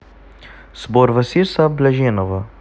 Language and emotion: Russian, neutral